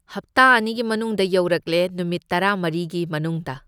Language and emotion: Manipuri, neutral